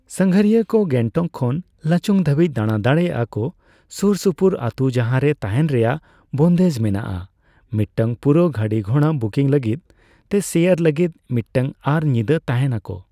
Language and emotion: Santali, neutral